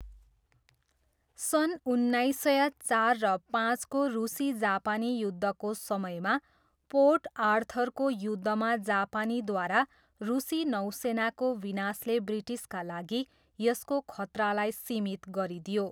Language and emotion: Nepali, neutral